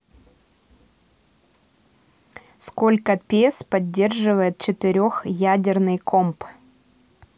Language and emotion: Russian, neutral